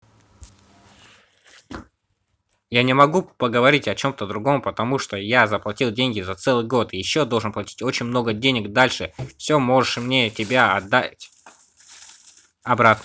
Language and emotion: Russian, angry